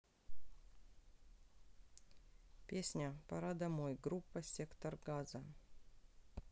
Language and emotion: Russian, neutral